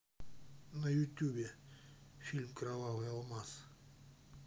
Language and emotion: Russian, neutral